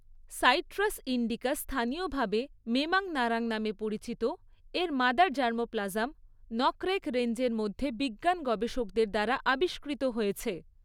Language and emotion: Bengali, neutral